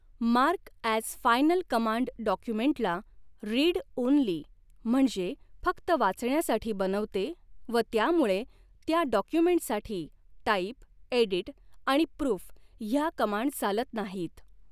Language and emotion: Marathi, neutral